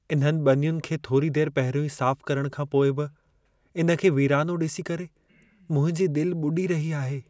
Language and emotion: Sindhi, sad